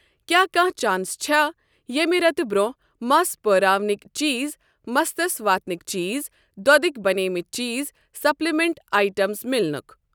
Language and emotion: Kashmiri, neutral